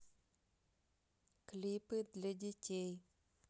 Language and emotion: Russian, neutral